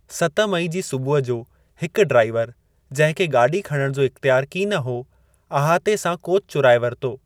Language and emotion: Sindhi, neutral